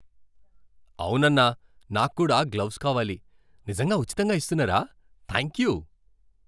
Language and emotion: Telugu, happy